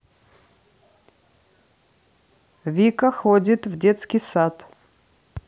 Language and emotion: Russian, neutral